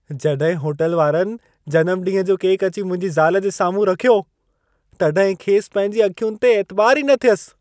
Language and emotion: Sindhi, surprised